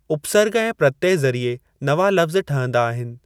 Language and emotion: Sindhi, neutral